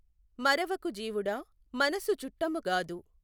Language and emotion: Telugu, neutral